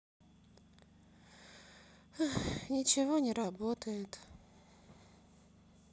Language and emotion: Russian, sad